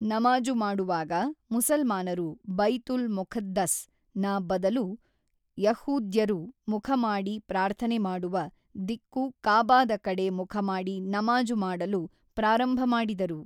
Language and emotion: Kannada, neutral